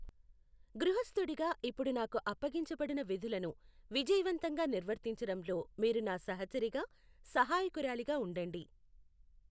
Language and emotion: Telugu, neutral